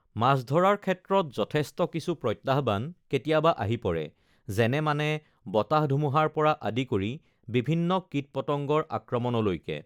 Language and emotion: Assamese, neutral